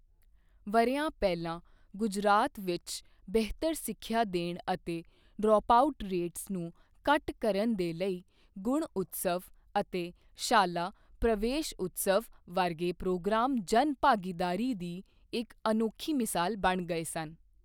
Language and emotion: Punjabi, neutral